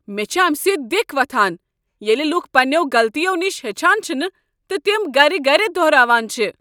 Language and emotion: Kashmiri, angry